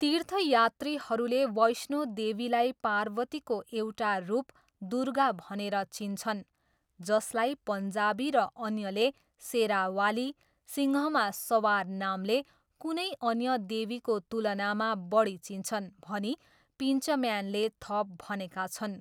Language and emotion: Nepali, neutral